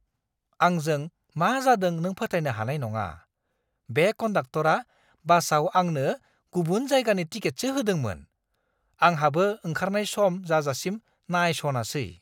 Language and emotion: Bodo, surprised